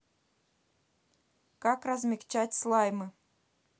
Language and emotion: Russian, neutral